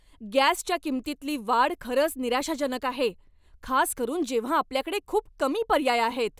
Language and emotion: Marathi, angry